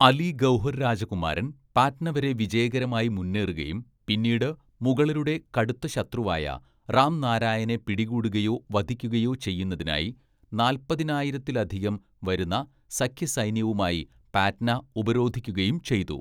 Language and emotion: Malayalam, neutral